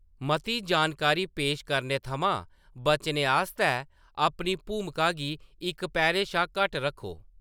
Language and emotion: Dogri, neutral